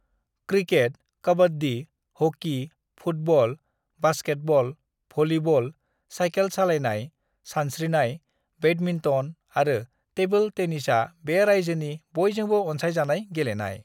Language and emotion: Bodo, neutral